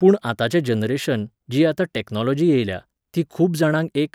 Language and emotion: Goan Konkani, neutral